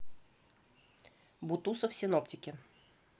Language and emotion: Russian, neutral